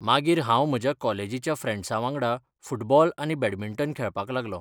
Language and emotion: Goan Konkani, neutral